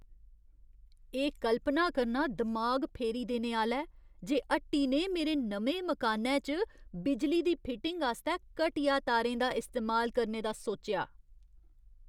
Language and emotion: Dogri, disgusted